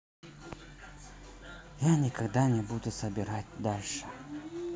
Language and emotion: Russian, sad